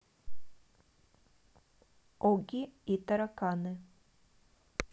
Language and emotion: Russian, neutral